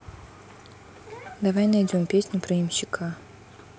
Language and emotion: Russian, neutral